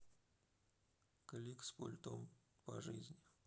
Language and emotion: Russian, sad